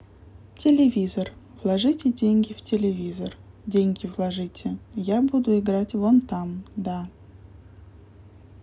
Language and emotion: Russian, neutral